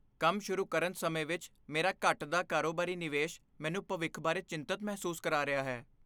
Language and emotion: Punjabi, fearful